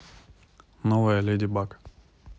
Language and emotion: Russian, neutral